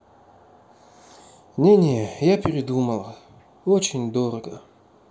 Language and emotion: Russian, sad